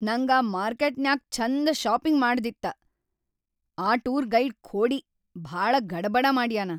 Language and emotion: Kannada, angry